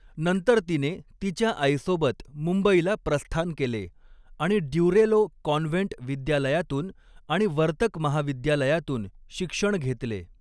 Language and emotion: Marathi, neutral